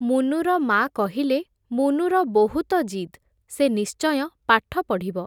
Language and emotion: Odia, neutral